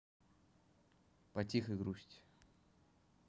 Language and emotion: Russian, neutral